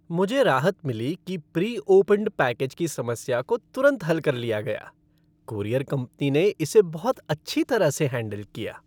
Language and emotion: Hindi, happy